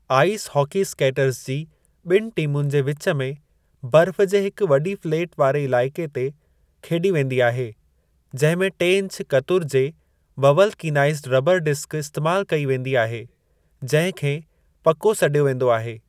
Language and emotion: Sindhi, neutral